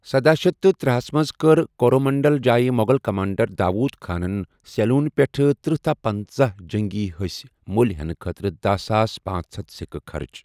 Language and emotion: Kashmiri, neutral